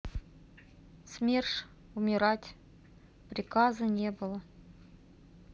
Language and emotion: Russian, sad